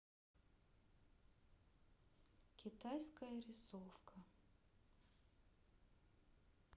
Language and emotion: Russian, sad